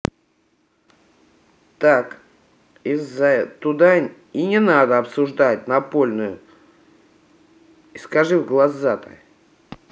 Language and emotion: Russian, angry